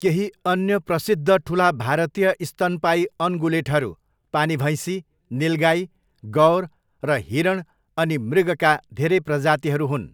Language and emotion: Nepali, neutral